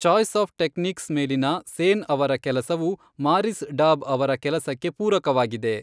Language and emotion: Kannada, neutral